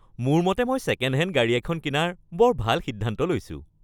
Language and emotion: Assamese, happy